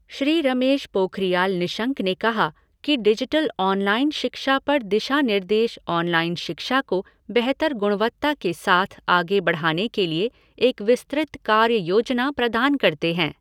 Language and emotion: Hindi, neutral